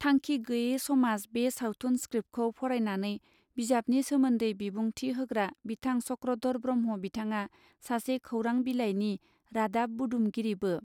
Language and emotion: Bodo, neutral